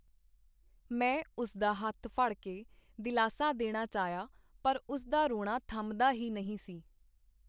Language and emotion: Punjabi, neutral